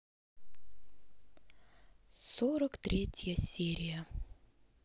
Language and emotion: Russian, sad